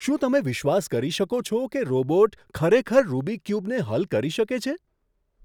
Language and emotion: Gujarati, surprised